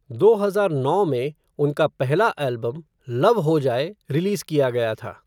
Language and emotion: Hindi, neutral